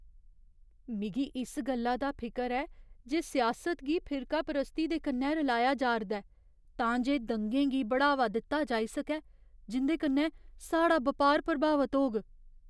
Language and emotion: Dogri, fearful